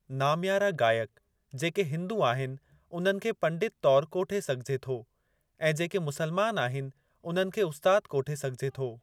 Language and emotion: Sindhi, neutral